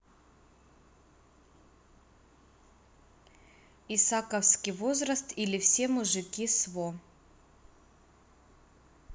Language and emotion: Russian, neutral